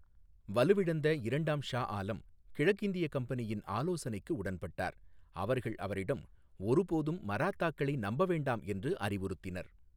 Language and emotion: Tamil, neutral